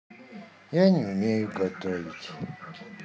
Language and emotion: Russian, sad